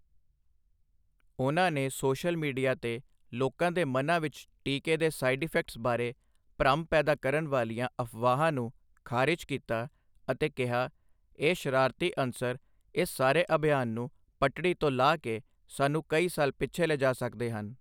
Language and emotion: Punjabi, neutral